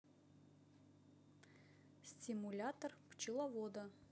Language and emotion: Russian, neutral